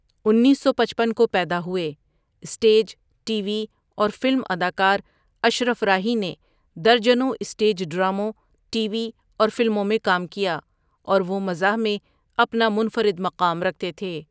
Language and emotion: Urdu, neutral